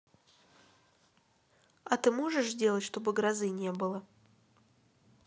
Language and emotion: Russian, neutral